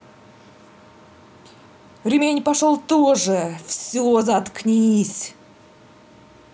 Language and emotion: Russian, angry